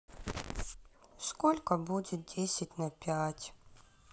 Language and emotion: Russian, sad